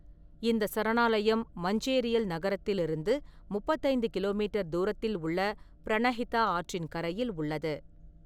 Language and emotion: Tamil, neutral